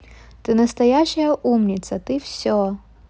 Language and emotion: Russian, positive